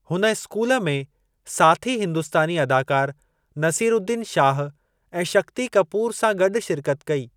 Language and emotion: Sindhi, neutral